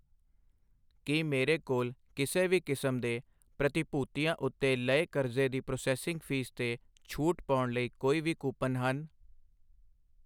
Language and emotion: Punjabi, neutral